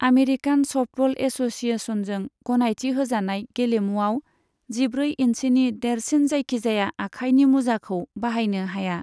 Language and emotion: Bodo, neutral